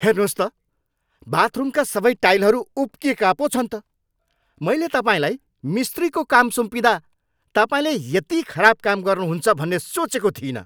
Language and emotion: Nepali, angry